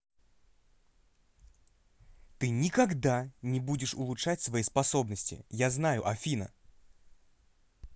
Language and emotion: Russian, angry